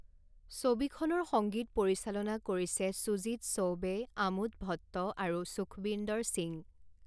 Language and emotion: Assamese, neutral